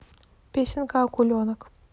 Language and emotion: Russian, neutral